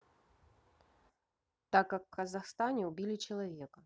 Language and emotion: Russian, neutral